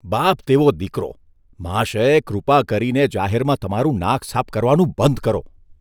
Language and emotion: Gujarati, disgusted